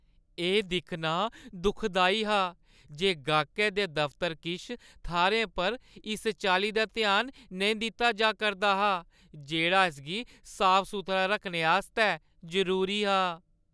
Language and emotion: Dogri, sad